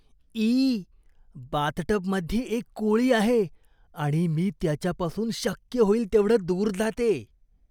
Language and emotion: Marathi, disgusted